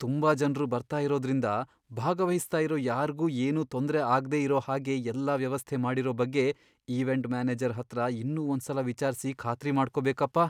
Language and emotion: Kannada, fearful